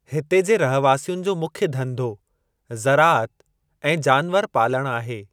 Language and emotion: Sindhi, neutral